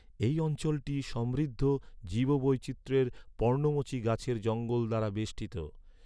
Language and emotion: Bengali, neutral